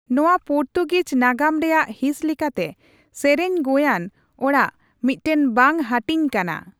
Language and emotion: Santali, neutral